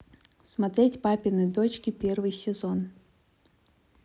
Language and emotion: Russian, neutral